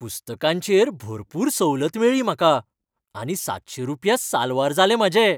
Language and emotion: Goan Konkani, happy